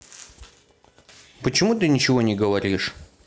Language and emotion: Russian, neutral